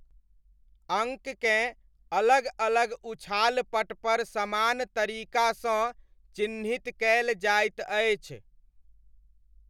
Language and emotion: Maithili, neutral